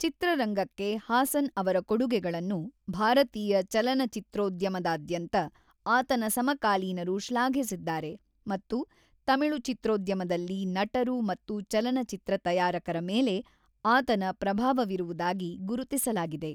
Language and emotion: Kannada, neutral